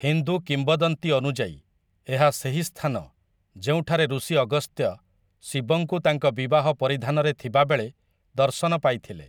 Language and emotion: Odia, neutral